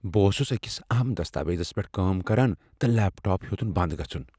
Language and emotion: Kashmiri, fearful